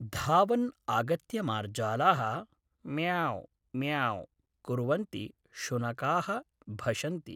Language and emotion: Sanskrit, neutral